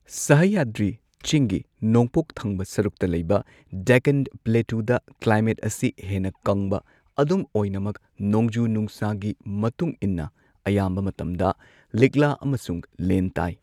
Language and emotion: Manipuri, neutral